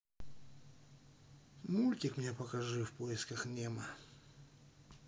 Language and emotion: Russian, sad